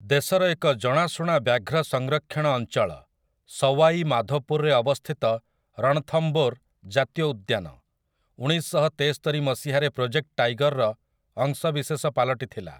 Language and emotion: Odia, neutral